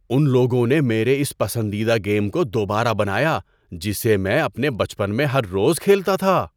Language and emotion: Urdu, surprised